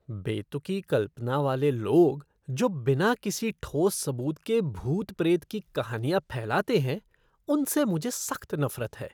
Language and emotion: Hindi, disgusted